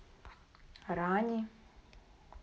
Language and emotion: Russian, neutral